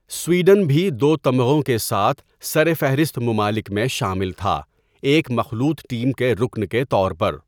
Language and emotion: Urdu, neutral